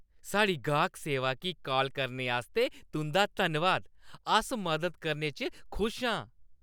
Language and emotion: Dogri, happy